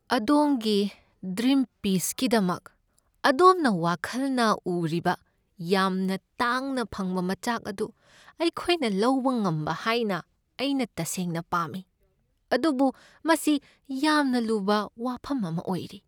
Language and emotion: Manipuri, sad